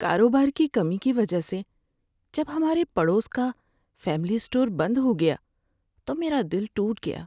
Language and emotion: Urdu, sad